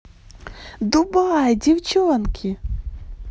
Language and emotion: Russian, positive